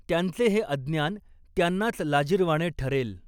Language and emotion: Marathi, neutral